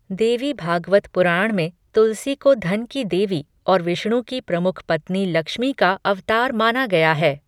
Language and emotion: Hindi, neutral